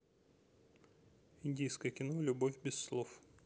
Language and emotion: Russian, neutral